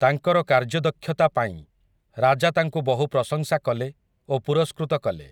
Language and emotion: Odia, neutral